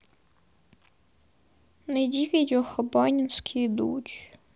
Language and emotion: Russian, sad